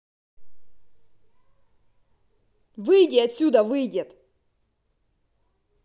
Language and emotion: Russian, angry